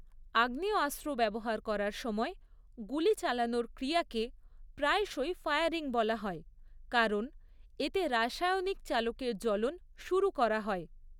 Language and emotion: Bengali, neutral